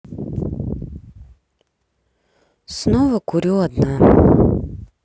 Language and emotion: Russian, sad